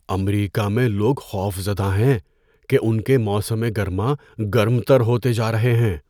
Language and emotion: Urdu, fearful